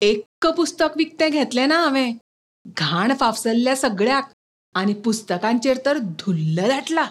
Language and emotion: Goan Konkani, disgusted